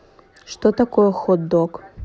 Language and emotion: Russian, neutral